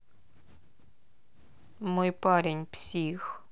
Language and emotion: Russian, sad